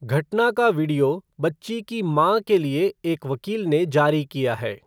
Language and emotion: Hindi, neutral